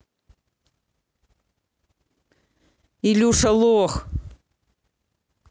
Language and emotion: Russian, angry